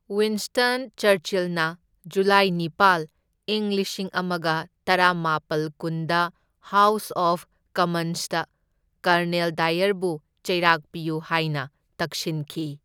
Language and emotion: Manipuri, neutral